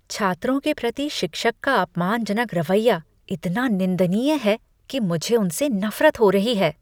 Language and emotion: Hindi, disgusted